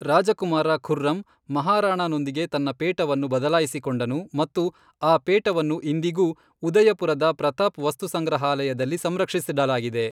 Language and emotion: Kannada, neutral